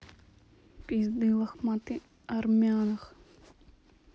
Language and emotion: Russian, neutral